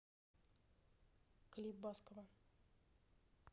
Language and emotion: Russian, neutral